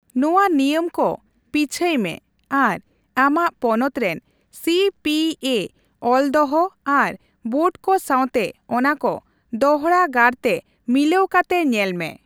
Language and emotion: Santali, neutral